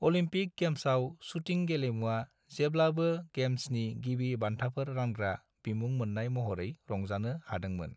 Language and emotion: Bodo, neutral